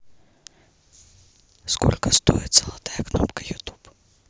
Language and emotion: Russian, neutral